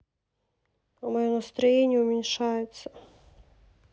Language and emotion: Russian, sad